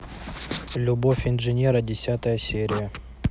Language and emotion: Russian, neutral